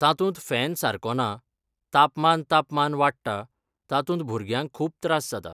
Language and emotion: Goan Konkani, neutral